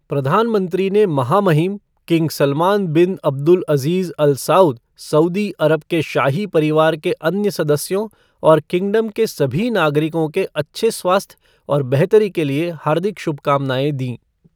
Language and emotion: Hindi, neutral